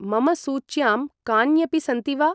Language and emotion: Sanskrit, neutral